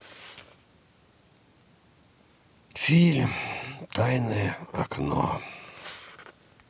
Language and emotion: Russian, sad